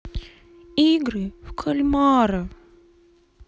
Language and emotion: Russian, sad